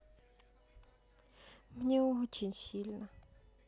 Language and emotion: Russian, sad